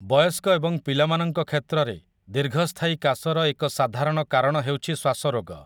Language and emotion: Odia, neutral